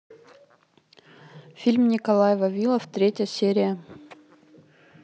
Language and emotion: Russian, neutral